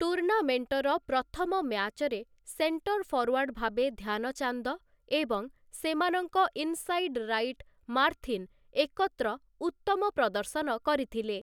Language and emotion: Odia, neutral